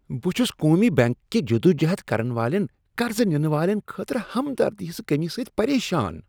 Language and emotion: Kashmiri, disgusted